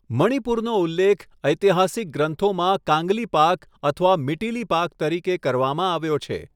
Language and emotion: Gujarati, neutral